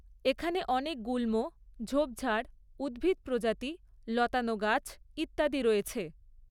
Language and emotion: Bengali, neutral